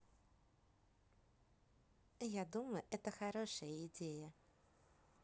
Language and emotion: Russian, neutral